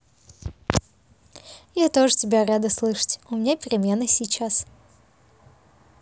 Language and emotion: Russian, positive